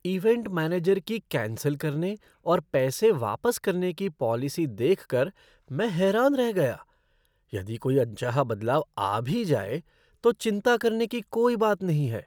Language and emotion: Hindi, surprised